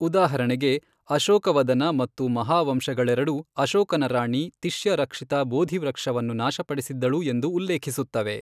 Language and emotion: Kannada, neutral